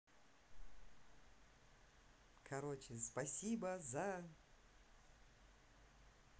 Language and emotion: Russian, neutral